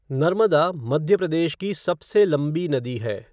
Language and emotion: Hindi, neutral